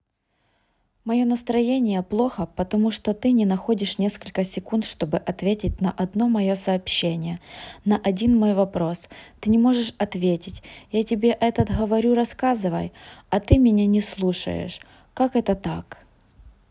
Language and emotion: Russian, sad